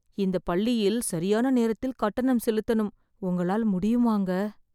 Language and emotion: Tamil, sad